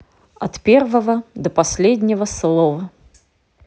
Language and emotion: Russian, neutral